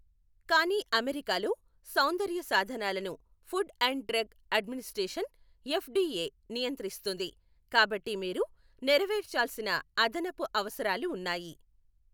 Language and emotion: Telugu, neutral